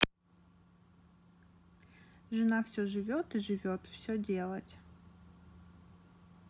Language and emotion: Russian, neutral